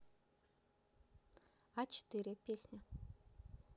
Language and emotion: Russian, neutral